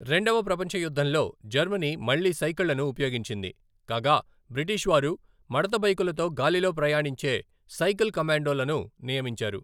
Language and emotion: Telugu, neutral